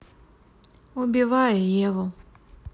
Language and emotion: Russian, neutral